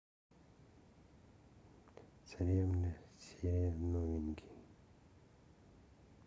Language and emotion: Russian, sad